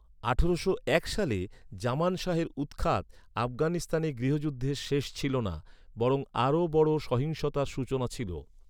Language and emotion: Bengali, neutral